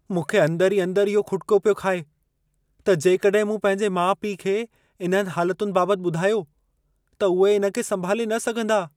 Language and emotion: Sindhi, fearful